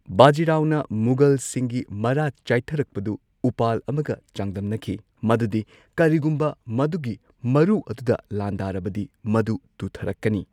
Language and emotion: Manipuri, neutral